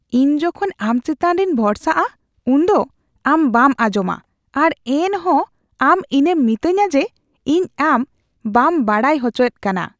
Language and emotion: Santali, disgusted